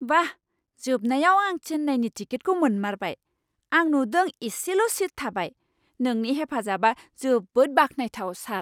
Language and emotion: Bodo, surprised